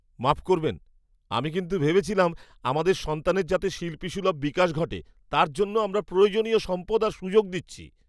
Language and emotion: Bengali, surprised